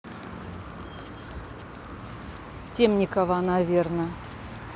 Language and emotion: Russian, neutral